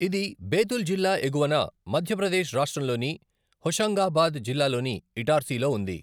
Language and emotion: Telugu, neutral